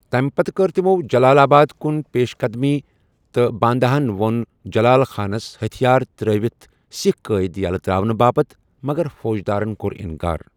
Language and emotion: Kashmiri, neutral